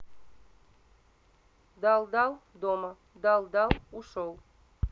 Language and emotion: Russian, neutral